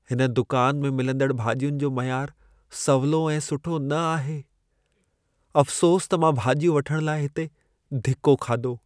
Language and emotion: Sindhi, sad